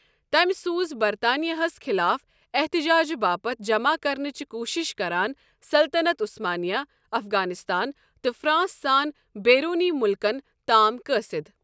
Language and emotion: Kashmiri, neutral